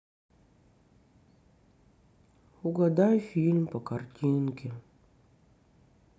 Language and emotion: Russian, sad